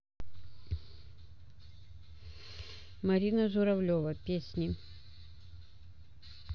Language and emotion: Russian, neutral